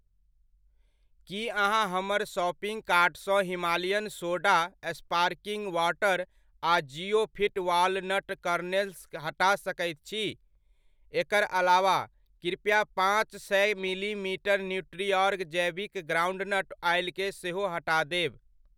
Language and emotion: Maithili, neutral